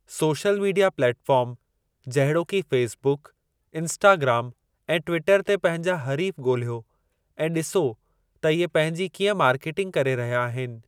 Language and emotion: Sindhi, neutral